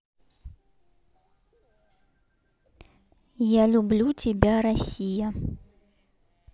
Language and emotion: Russian, neutral